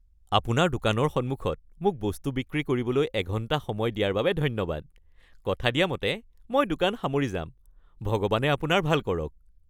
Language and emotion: Assamese, happy